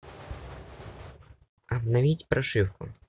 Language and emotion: Russian, neutral